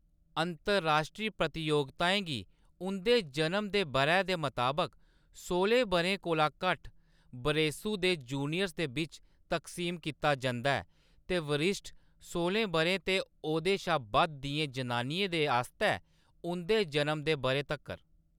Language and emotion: Dogri, neutral